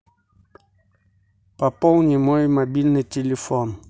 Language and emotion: Russian, neutral